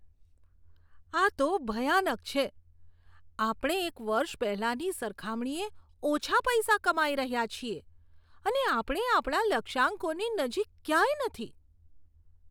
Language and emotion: Gujarati, disgusted